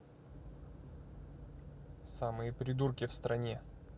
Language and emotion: Russian, angry